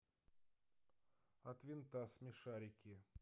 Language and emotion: Russian, neutral